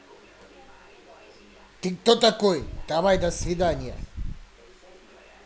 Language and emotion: Russian, angry